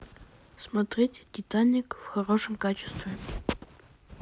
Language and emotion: Russian, neutral